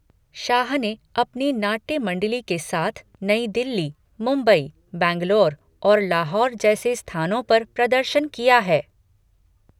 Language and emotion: Hindi, neutral